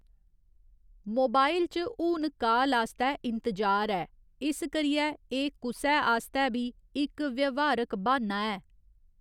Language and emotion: Dogri, neutral